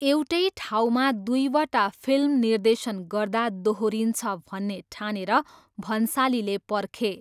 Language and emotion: Nepali, neutral